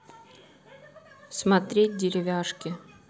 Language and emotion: Russian, neutral